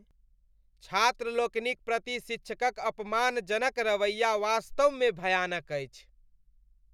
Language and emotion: Maithili, disgusted